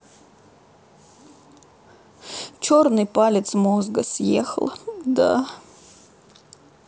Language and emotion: Russian, sad